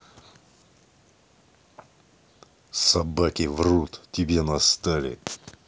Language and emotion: Russian, angry